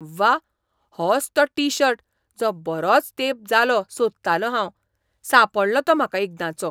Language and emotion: Goan Konkani, surprised